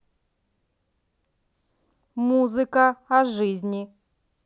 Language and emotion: Russian, neutral